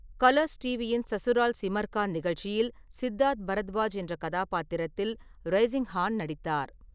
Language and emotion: Tamil, neutral